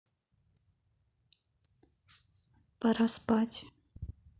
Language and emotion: Russian, neutral